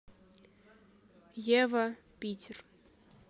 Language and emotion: Russian, neutral